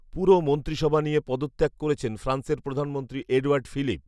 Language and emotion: Bengali, neutral